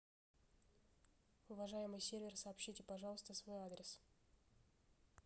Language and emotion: Russian, neutral